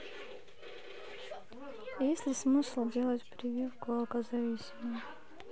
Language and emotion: Russian, sad